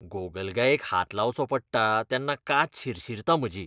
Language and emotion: Goan Konkani, disgusted